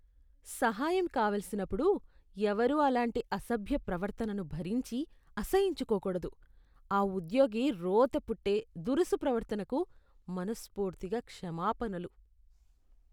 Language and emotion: Telugu, disgusted